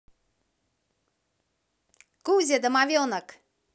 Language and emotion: Russian, positive